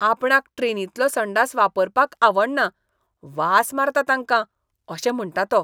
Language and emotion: Goan Konkani, disgusted